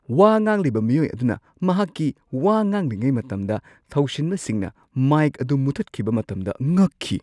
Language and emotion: Manipuri, surprised